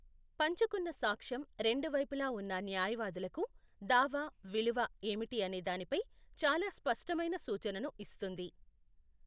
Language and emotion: Telugu, neutral